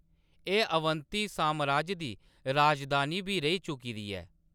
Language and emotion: Dogri, neutral